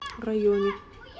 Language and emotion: Russian, neutral